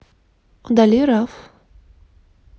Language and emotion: Russian, neutral